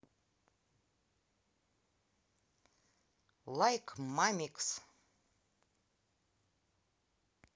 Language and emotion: Russian, positive